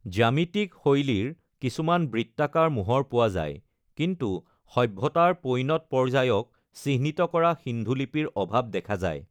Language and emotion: Assamese, neutral